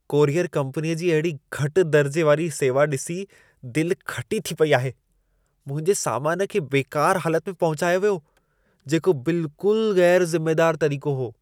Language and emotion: Sindhi, disgusted